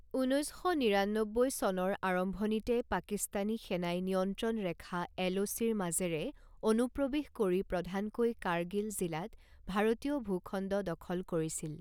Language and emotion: Assamese, neutral